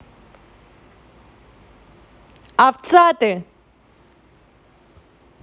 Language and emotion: Russian, angry